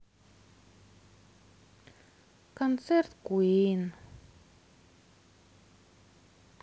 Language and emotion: Russian, sad